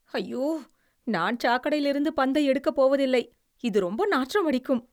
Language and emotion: Tamil, disgusted